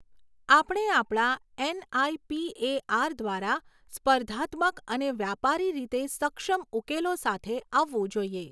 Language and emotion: Gujarati, neutral